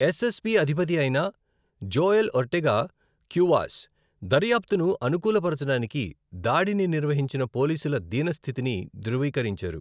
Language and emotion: Telugu, neutral